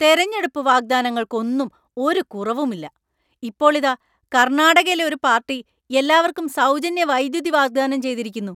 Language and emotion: Malayalam, angry